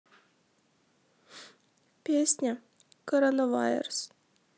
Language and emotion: Russian, sad